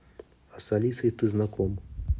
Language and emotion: Russian, neutral